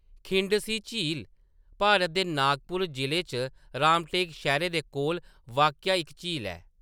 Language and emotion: Dogri, neutral